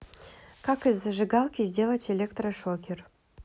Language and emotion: Russian, neutral